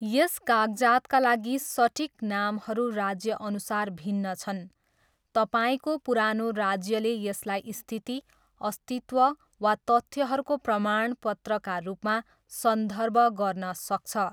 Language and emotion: Nepali, neutral